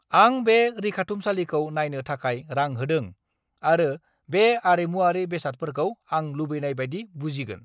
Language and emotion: Bodo, angry